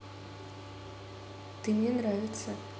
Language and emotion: Russian, neutral